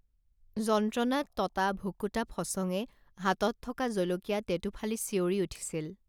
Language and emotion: Assamese, neutral